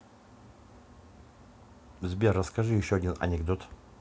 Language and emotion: Russian, neutral